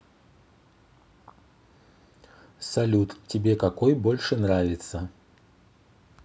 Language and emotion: Russian, neutral